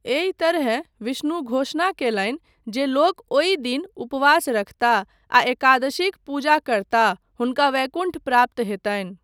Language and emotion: Maithili, neutral